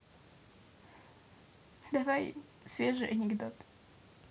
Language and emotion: Russian, sad